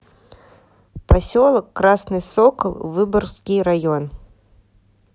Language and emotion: Russian, neutral